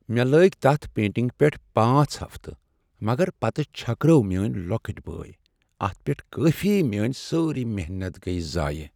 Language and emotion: Kashmiri, sad